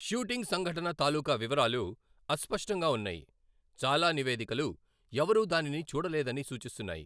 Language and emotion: Telugu, neutral